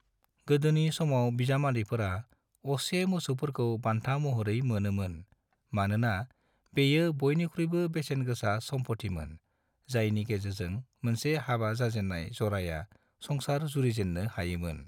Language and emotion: Bodo, neutral